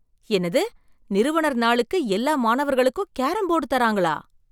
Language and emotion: Tamil, surprised